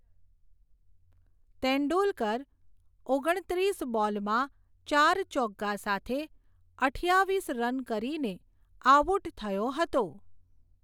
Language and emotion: Gujarati, neutral